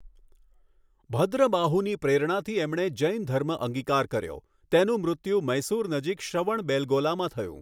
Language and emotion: Gujarati, neutral